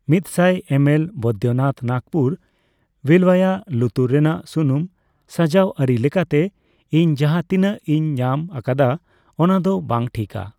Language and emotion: Santali, neutral